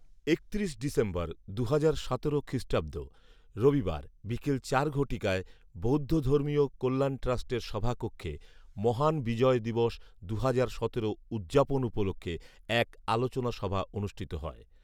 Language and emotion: Bengali, neutral